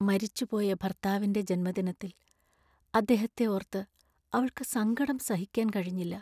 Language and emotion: Malayalam, sad